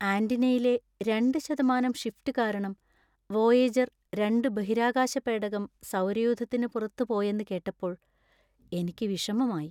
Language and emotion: Malayalam, sad